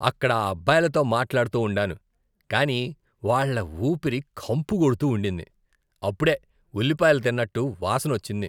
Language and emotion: Telugu, disgusted